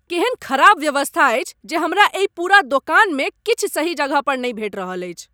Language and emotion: Maithili, angry